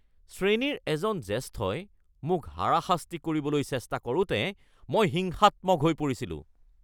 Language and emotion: Assamese, angry